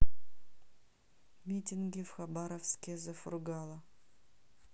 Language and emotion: Russian, neutral